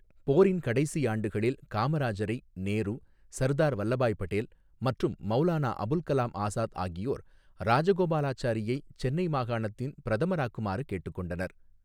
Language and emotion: Tamil, neutral